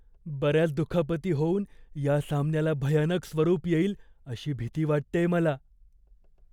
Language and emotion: Marathi, fearful